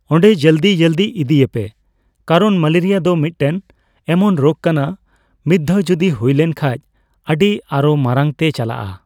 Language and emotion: Santali, neutral